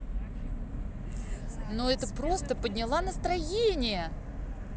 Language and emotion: Russian, positive